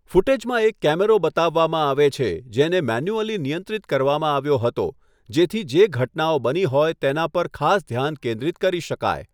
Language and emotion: Gujarati, neutral